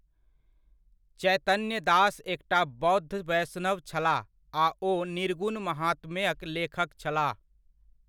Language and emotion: Maithili, neutral